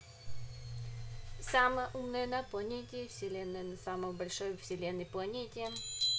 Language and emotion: Russian, neutral